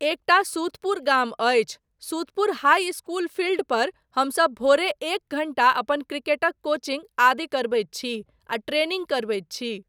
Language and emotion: Maithili, neutral